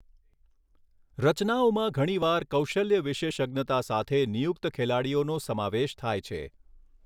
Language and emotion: Gujarati, neutral